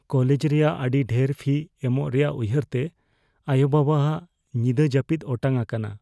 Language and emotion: Santali, fearful